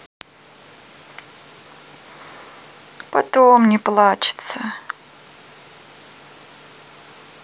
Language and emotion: Russian, sad